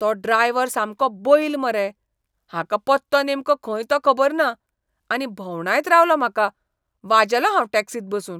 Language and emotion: Goan Konkani, disgusted